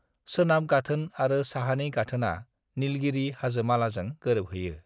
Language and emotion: Bodo, neutral